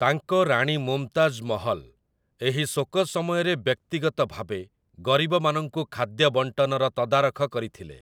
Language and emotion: Odia, neutral